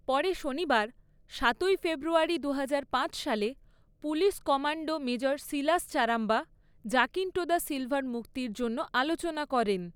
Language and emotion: Bengali, neutral